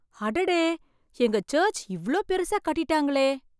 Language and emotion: Tamil, surprised